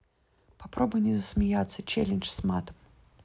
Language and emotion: Russian, neutral